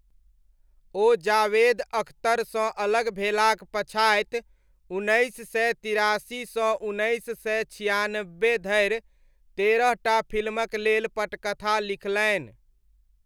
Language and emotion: Maithili, neutral